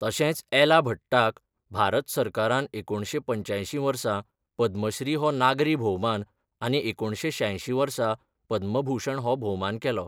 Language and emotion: Goan Konkani, neutral